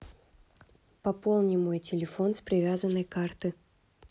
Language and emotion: Russian, neutral